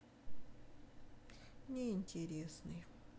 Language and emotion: Russian, sad